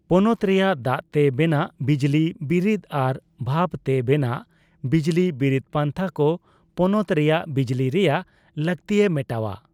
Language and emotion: Santali, neutral